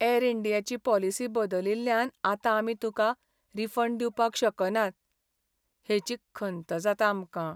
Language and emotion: Goan Konkani, sad